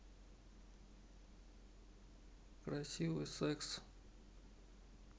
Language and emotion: Russian, neutral